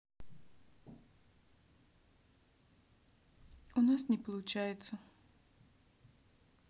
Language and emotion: Russian, sad